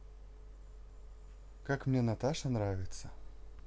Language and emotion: Russian, positive